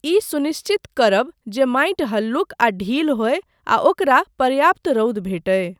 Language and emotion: Maithili, neutral